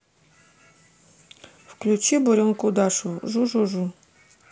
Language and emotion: Russian, neutral